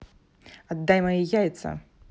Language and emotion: Russian, angry